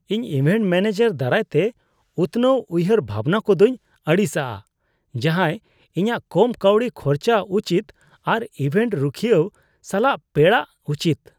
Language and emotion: Santali, disgusted